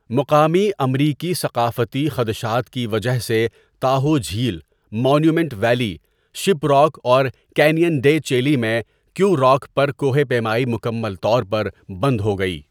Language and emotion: Urdu, neutral